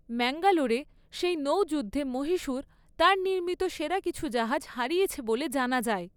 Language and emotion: Bengali, neutral